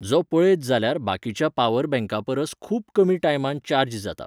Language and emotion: Goan Konkani, neutral